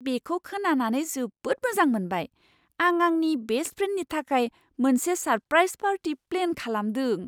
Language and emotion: Bodo, surprised